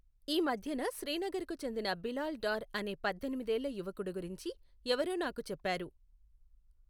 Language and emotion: Telugu, neutral